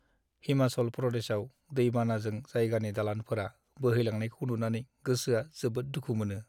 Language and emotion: Bodo, sad